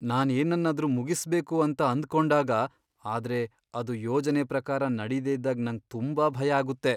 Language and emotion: Kannada, fearful